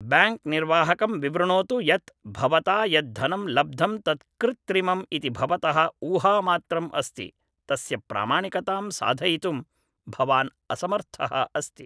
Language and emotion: Sanskrit, neutral